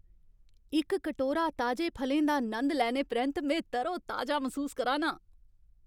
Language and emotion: Dogri, happy